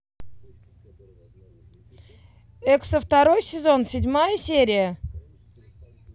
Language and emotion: Russian, positive